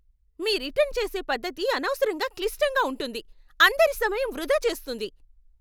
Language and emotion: Telugu, angry